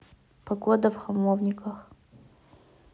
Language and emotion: Russian, neutral